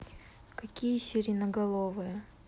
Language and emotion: Russian, neutral